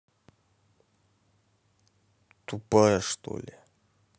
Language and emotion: Russian, angry